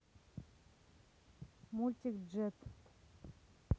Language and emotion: Russian, neutral